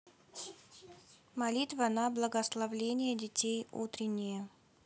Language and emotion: Russian, neutral